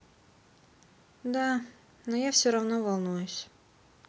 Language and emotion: Russian, sad